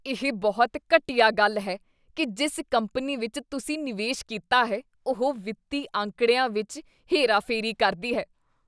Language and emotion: Punjabi, disgusted